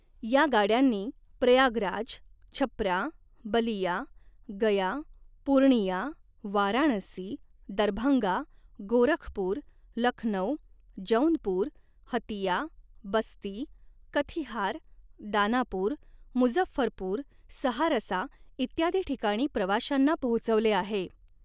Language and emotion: Marathi, neutral